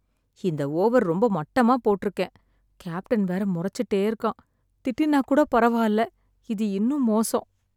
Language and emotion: Tamil, sad